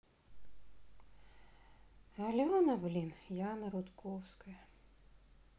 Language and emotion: Russian, sad